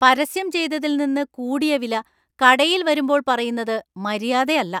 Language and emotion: Malayalam, angry